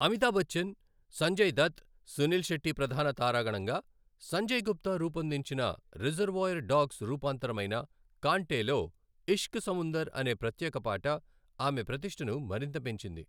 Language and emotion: Telugu, neutral